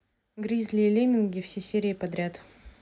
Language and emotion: Russian, neutral